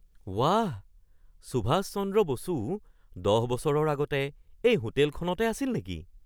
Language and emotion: Assamese, surprised